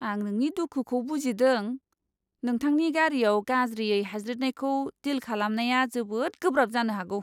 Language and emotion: Bodo, disgusted